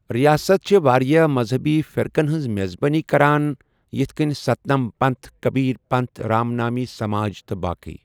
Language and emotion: Kashmiri, neutral